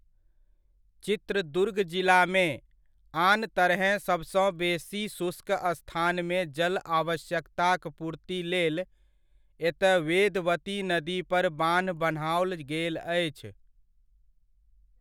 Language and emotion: Maithili, neutral